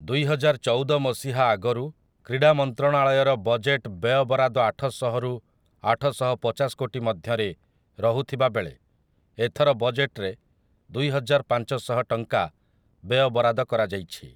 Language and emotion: Odia, neutral